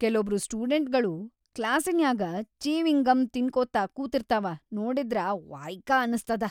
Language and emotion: Kannada, disgusted